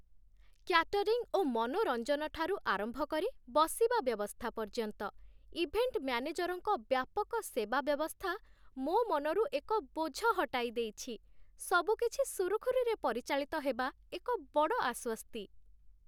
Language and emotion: Odia, happy